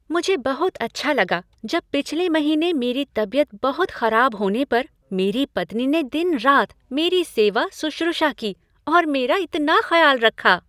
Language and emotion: Hindi, happy